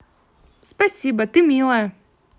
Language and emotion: Russian, positive